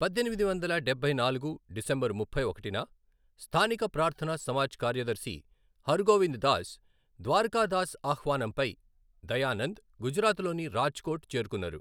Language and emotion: Telugu, neutral